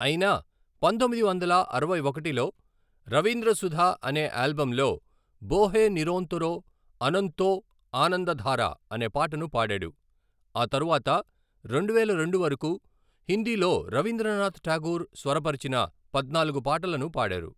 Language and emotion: Telugu, neutral